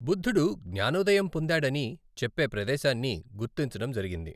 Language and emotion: Telugu, neutral